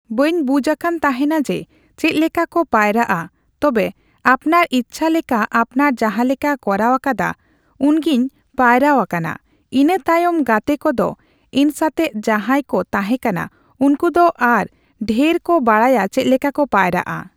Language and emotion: Santali, neutral